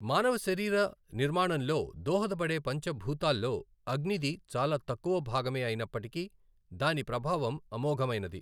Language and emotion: Telugu, neutral